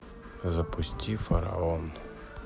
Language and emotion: Russian, neutral